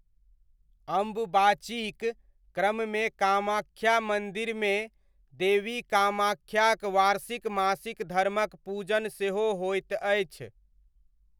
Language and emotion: Maithili, neutral